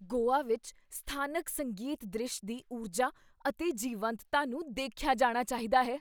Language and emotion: Punjabi, surprised